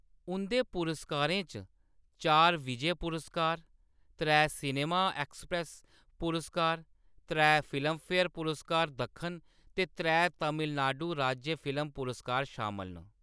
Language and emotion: Dogri, neutral